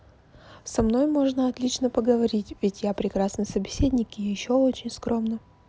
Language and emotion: Russian, neutral